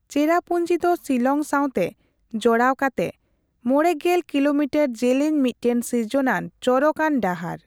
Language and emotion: Santali, neutral